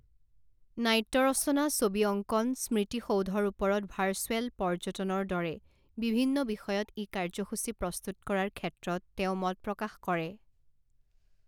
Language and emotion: Assamese, neutral